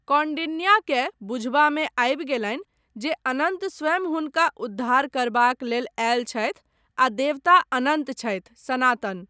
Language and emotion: Maithili, neutral